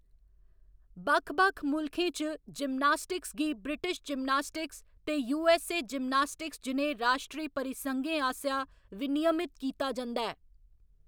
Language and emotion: Dogri, neutral